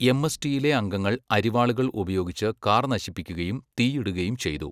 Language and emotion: Malayalam, neutral